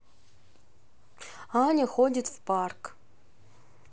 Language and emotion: Russian, neutral